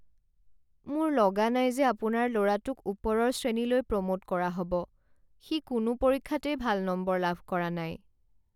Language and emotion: Assamese, sad